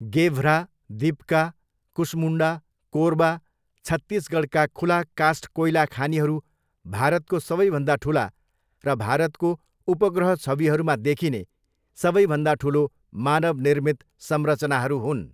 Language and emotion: Nepali, neutral